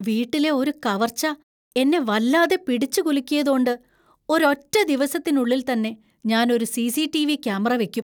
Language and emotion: Malayalam, fearful